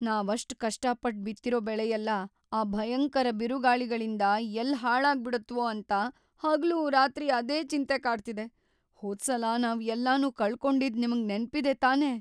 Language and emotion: Kannada, fearful